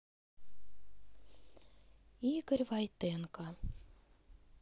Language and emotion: Russian, sad